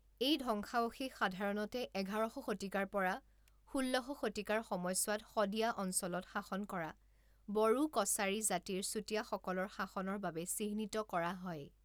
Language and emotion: Assamese, neutral